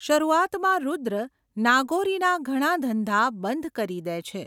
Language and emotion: Gujarati, neutral